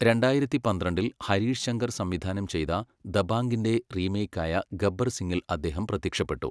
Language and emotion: Malayalam, neutral